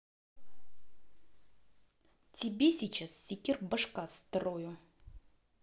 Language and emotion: Russian, angry